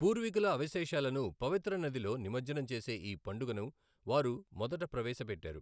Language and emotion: Telugu, neutral